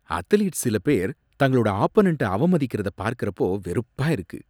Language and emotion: Tamil, disgusted